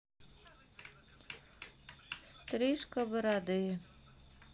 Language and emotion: Russian, sad